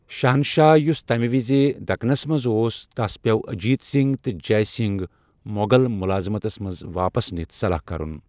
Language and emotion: Kashmiri, neutral